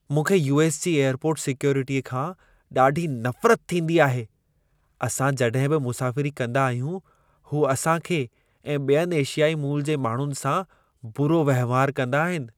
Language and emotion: Sindhi, disgusted